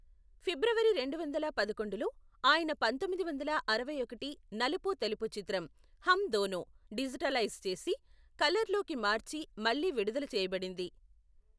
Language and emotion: Telugu, neutral